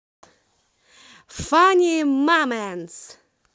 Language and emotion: Russian, positive